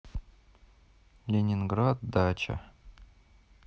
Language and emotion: Russian, neutral